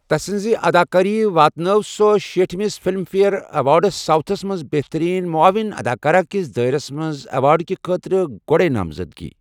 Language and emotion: Kashmiri, neutral